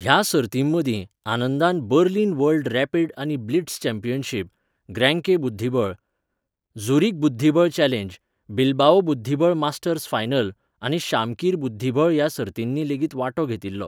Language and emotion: Goan Konkani, neutral